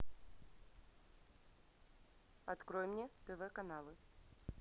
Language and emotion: Russian, neutral